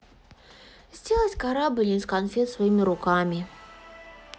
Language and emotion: Russian, sad